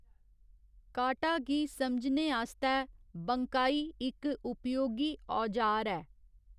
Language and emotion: Dogri, neutral